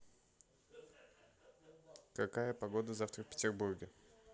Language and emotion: Russian, neutral